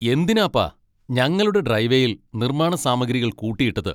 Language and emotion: Malayalam, angry